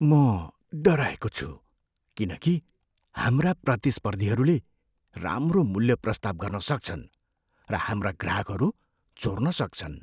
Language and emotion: Nepali, fearful